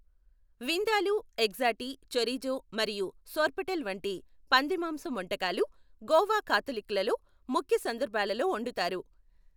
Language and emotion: Telugu, neutral